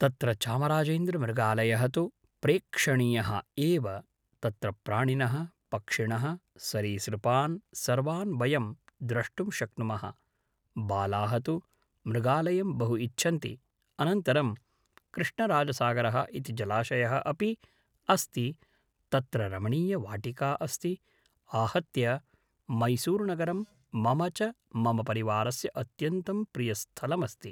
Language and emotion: Sanskrit, neutral